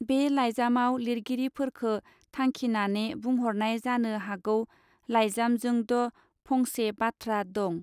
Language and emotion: Bodo, neutral